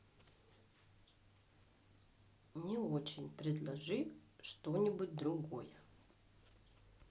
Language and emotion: Russian, neutral